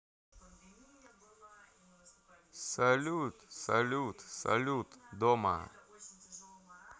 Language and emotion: Russian, neutral